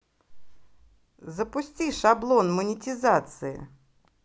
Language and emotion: Russian, positive